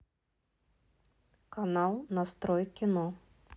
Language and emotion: Russian, neutral